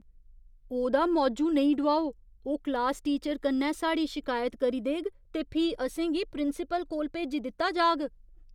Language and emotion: Dogri, fearful